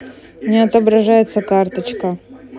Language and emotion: Russian, neutral